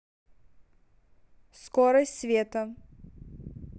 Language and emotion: Russian, neutral